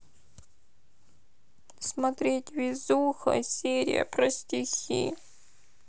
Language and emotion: Russian, sad